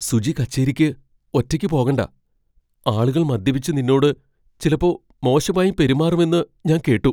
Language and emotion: Malayalam, fearful